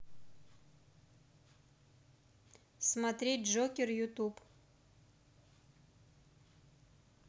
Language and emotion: Russian, neutral